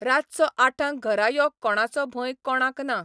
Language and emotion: Goan Konkani, neutral